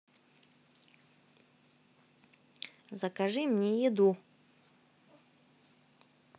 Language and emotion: Russian, neutral